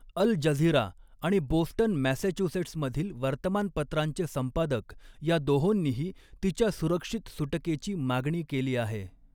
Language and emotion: Marathi, neutral